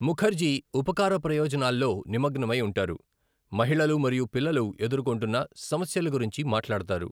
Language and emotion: Telugu, neutral